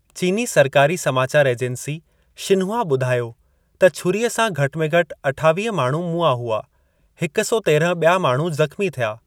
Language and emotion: Sindhi, neutral